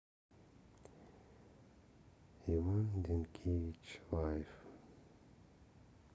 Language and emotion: Russian, sad